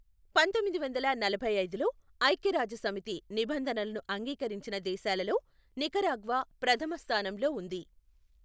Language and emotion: Telugu, neutral